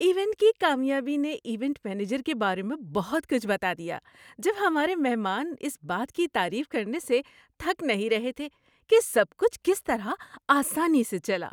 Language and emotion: Urdu, happy